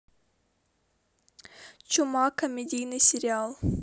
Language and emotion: Russian, neutral